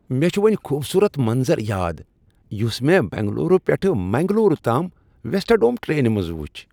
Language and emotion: Kashmiri, happy